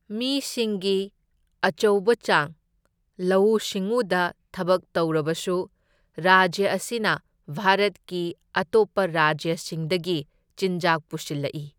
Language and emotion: Manipuri, neutral